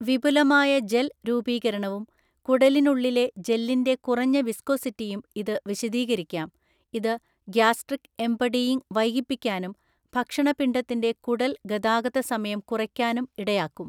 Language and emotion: Malayalam, neutral